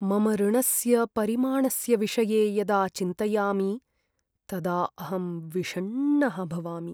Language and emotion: Sanskrit, sad